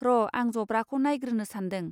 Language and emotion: Bodo, neutral